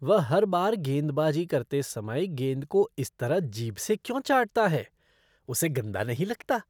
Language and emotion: Hindi, disgusted